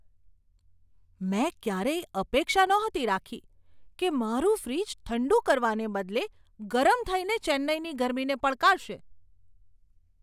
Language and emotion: Gujarati, surprised